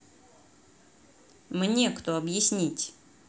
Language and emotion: Russian, angry